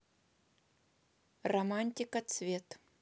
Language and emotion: Russian, neutral